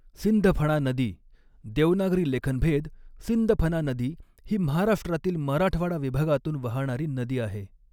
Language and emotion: Marathi, neutral